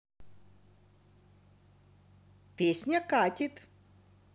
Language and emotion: Russian, positive